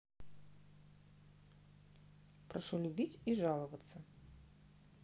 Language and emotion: Russian, neutral